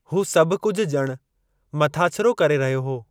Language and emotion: Sindhi, neutral